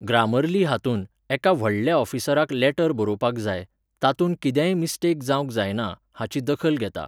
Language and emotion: Goan Konkani, neutral